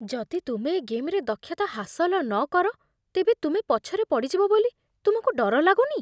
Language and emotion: Odia, fearful